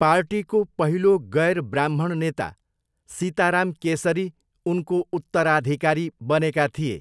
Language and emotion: Nepali, neutral